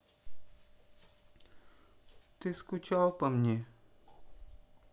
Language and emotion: Russian, sad